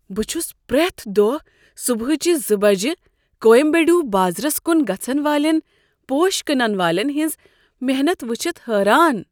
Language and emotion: Kashmiri, surprised